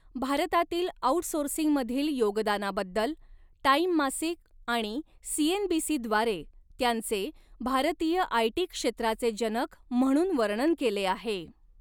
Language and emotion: Marathi, neutral